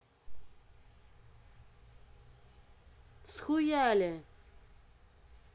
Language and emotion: Russian, angry